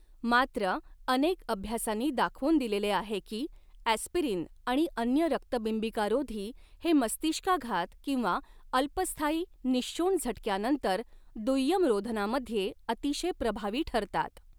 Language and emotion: Marathi, neutral